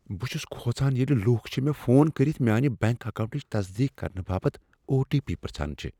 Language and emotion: Kashmiri, fearful